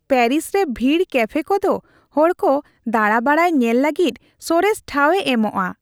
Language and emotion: Santali, happy